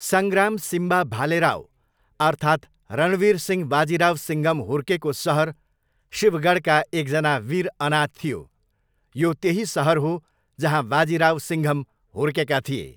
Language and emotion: Nepali, neutral